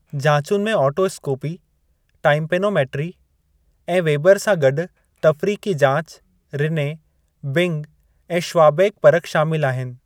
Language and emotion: Sindhi, neutral